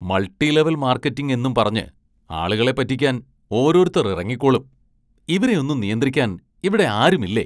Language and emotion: Malayalam, disgusted